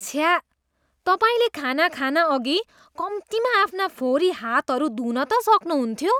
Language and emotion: Nepali, disgusted